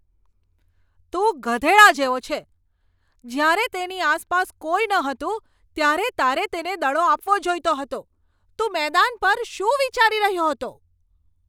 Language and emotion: Gujarati, angry